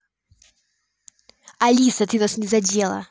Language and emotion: Russian, angry